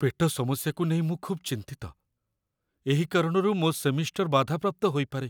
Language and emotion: Odia, fearful